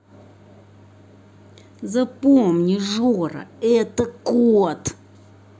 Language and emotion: Russian, angry